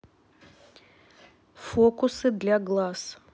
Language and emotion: Russian, neutral